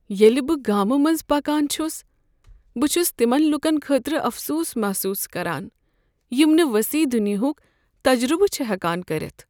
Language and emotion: Kashmiri, sad